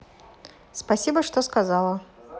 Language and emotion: Russian, neutral